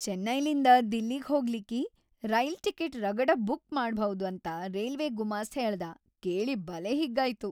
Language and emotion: Kannada, happy